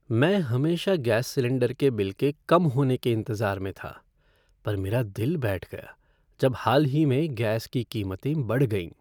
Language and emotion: Hindi, sad